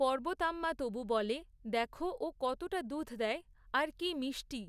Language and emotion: Bengali, neutral